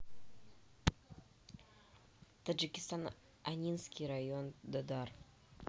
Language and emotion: Russian, neutral